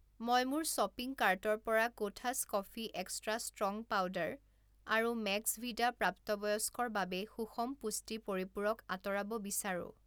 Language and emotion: Assamese, neutral